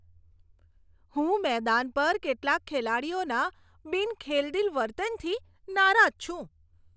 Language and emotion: Gujarati, disgusted